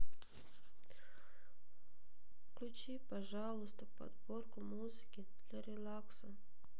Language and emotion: Russian, sad